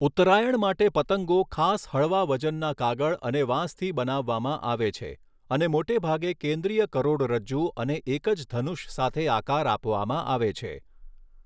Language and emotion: Gujarati, neutral